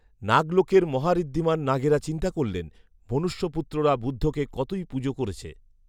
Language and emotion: Bengali, neutral